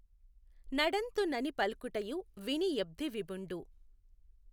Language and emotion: Telugu, neutral